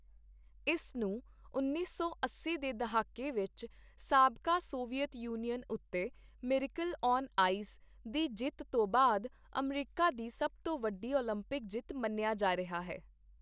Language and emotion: Punjabi, neutral